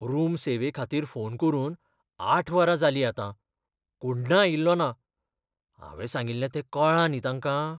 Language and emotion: Goan Konkani, fearful